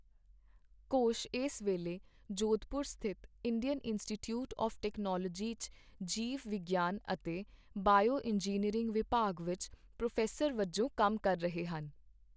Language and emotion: Punjabi, neutral